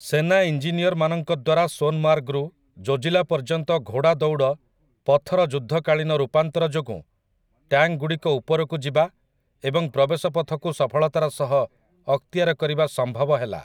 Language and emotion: Odia, neutral